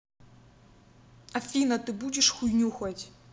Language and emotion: Russian, angry